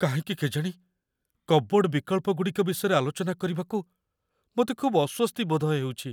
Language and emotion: Odia, fearful